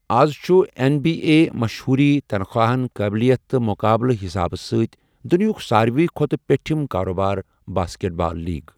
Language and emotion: Kashmiri, neutral